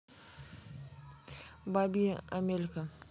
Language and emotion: Russian, neutral